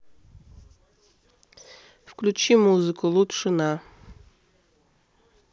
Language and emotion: Russian, neutral